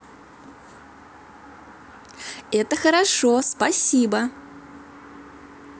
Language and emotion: Russian, positive